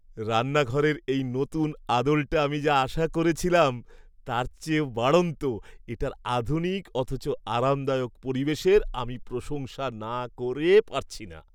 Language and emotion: Bengali, happy